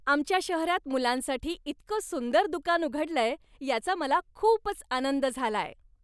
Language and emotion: Marathi, happy